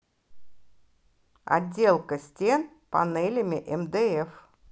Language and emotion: Russian, neutral